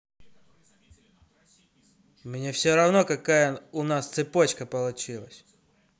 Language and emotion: Russian, angry